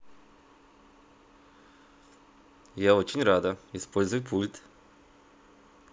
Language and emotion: Russian, positive